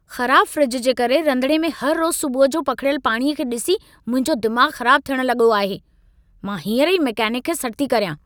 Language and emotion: Sindhi, angry